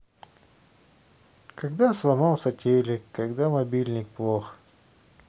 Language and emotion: Russian, neutral